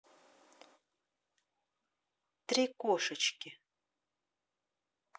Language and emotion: Russian, neutral